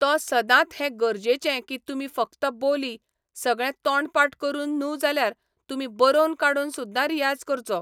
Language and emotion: Goan Konkani, neutral